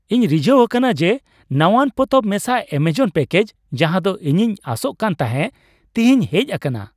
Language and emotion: Santali, happy